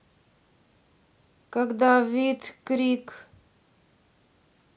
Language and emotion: Russian, neutral